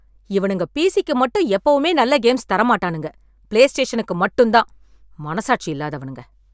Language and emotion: Tamil, angry